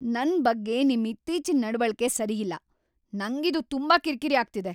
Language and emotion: Kannada, angry